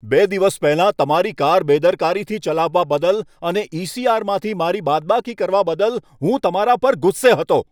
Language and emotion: Gujarati, angry